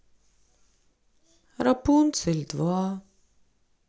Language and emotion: Russian, sad